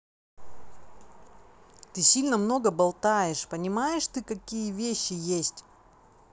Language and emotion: Russian, angry